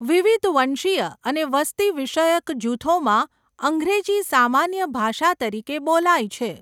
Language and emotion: Gujarati, neutral